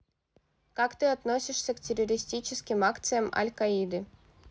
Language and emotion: Russian, neutral